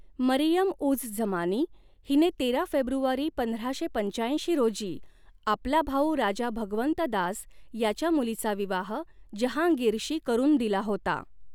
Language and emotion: Marathi, neutral